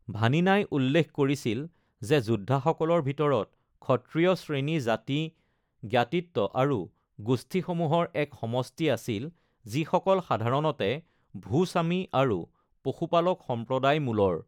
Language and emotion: Assamese, neutral